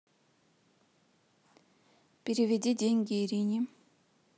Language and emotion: Russian, neutral